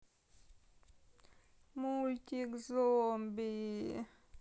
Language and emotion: Russian, sad